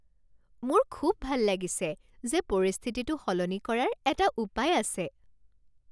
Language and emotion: Assamese, happy